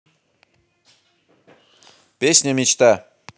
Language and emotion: Russian, positive